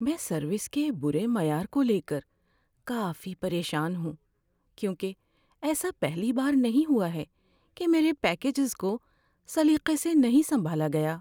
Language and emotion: Urdu, sad